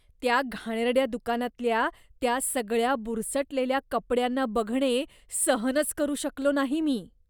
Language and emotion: Marathi, disgusted